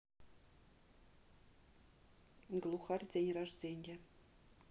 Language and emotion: Russian, neutral